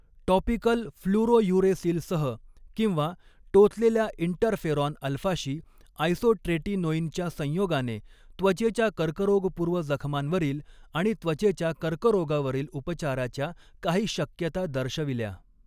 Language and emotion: Marathi, neutral